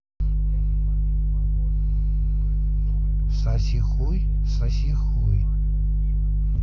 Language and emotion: Russian, neutral